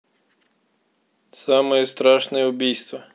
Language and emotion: Russian, neutral